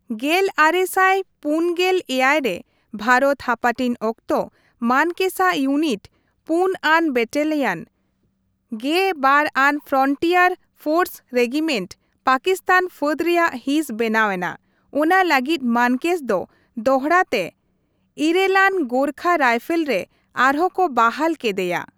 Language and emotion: Santali, neutral